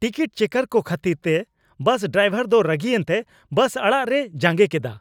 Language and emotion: Santali, angry